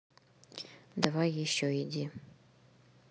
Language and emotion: Russian, neutral